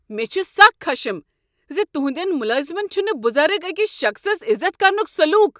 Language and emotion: Kashmiri, angry